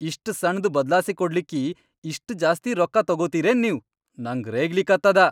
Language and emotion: Kannada, angry